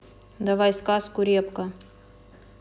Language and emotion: Russian, neutral